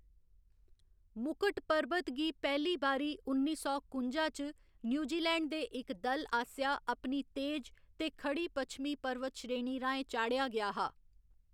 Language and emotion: Dogri, neutral